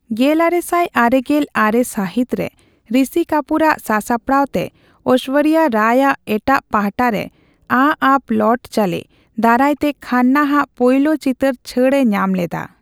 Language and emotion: Santali, neutral